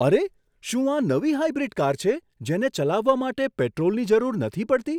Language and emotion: Gujarati, surprised